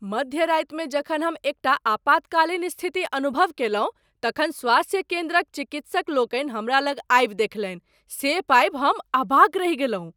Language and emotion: Maithili, surprised